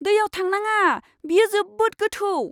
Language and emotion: Bodo, fearful